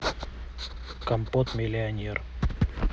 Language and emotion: Russian, neutral